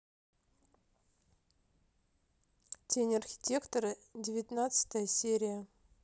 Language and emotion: Russian, neutral